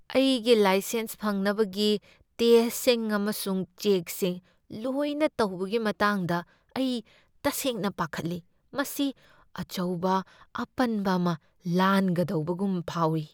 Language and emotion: Manipuri, fearful